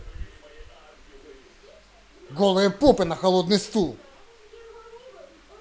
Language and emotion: Russian, angry